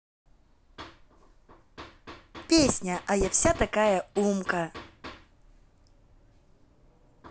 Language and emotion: Russian, positive